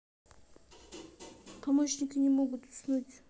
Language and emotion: Russian, neutral